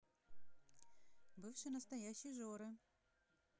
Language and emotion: Russian, positive